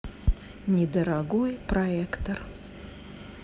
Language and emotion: Russian, neutral